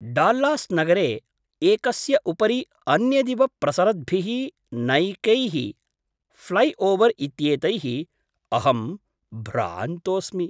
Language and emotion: Sanskrit, surprised